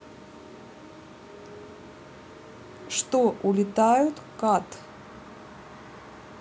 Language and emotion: Russian, neutral